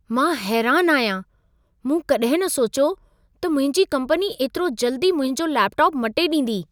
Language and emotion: Sindhi, surprised